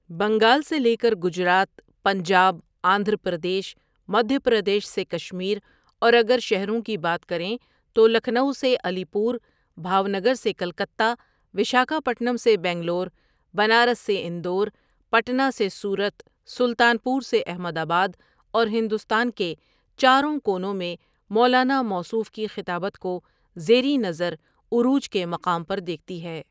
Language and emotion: Urdu, neutral